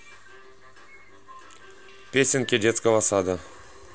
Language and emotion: Russian, neutral